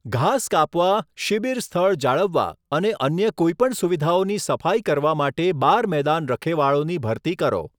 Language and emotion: Gujarati, neutral